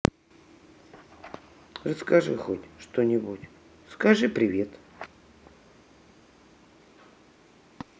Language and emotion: Russian, neutral